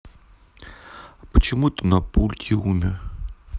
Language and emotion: Russian, sad